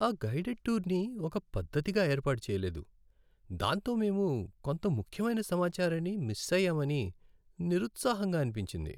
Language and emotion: Telugu, sad